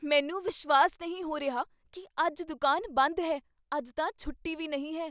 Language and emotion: Punjabi, surprised